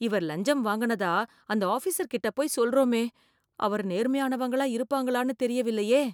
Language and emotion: Tamil, fearful